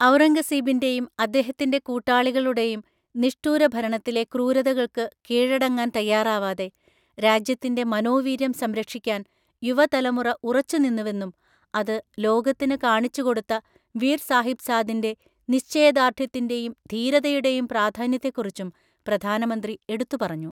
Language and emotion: Malayalam, neutral